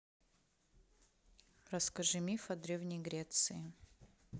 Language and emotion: Russian, neutral